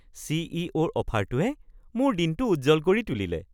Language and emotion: Assamese, happy